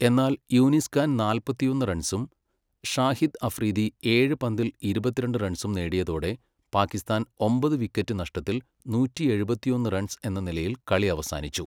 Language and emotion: Malayalam, neutral